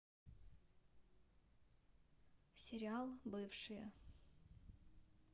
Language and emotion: Russian, neutral